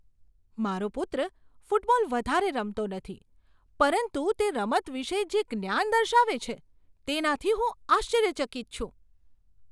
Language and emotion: Gujarati, surprised